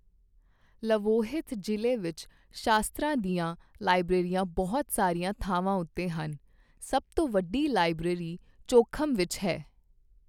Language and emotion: Punjabi, neutral